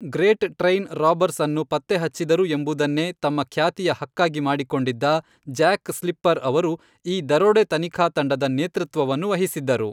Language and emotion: Kannada, neutral